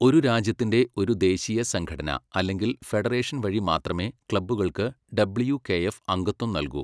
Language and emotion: Malayalam, neutral